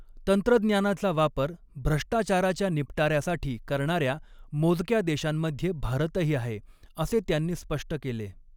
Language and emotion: Marathi, neutral